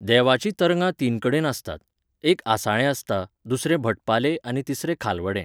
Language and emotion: Goan Konkani, neutral